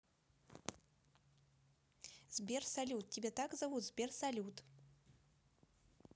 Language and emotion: Russian, neutral